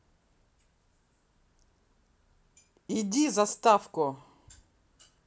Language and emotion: Russian, angry